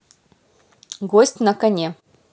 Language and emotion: Russian, positive